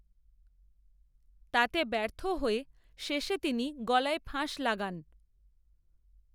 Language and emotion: Bengali, neutral